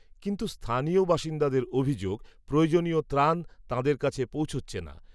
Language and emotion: Bengali, neutral